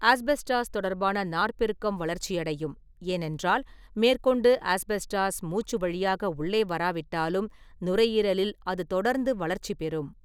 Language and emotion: Tamil, neutral